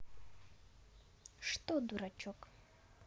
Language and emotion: Russian, neutral